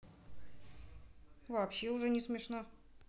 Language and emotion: Russian, neutral